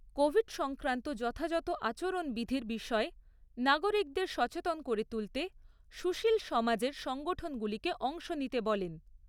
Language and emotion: Bengali, neutral